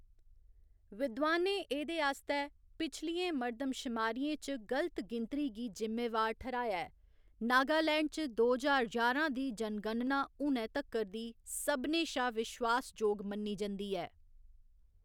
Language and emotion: Dogri, neutral